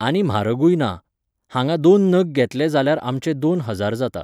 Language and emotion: Goan Konkani, neutral